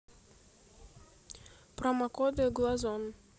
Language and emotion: Russian, neutral